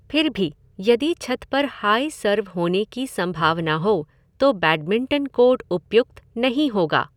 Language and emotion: Hindi, neutral